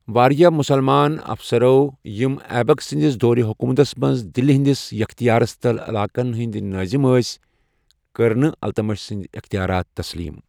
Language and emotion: Kashmiri, neutral